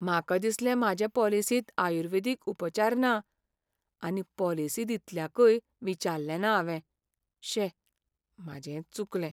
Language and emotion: Goan Konkani, sad